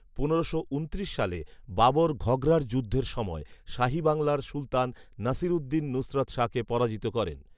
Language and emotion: Bengali, neutral